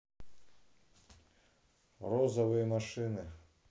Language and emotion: Russian, neutral